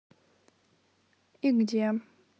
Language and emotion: Russian, neutral